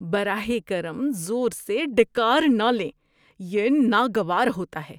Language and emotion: Urdu, disgusted